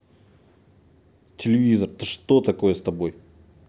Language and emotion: Russian, angry